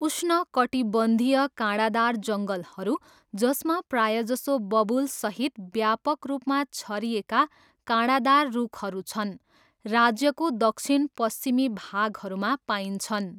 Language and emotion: Nepali, neutral